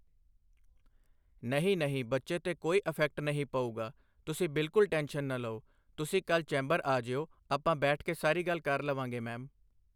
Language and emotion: Punjabi, neutral